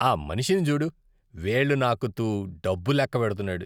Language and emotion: Telugu, disgusted